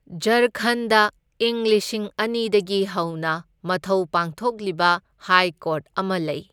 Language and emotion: Manipuri, neutral